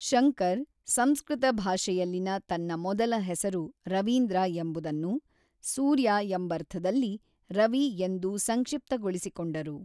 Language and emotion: Kannada, neutral